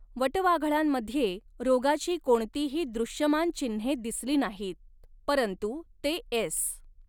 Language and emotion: Marathi, neutral